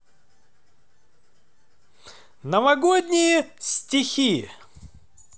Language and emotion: Russian, positive